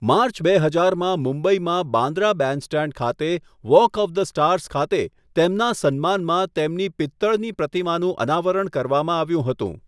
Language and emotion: Gujarati, neutral